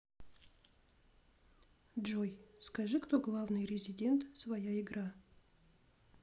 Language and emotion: Russian, neutral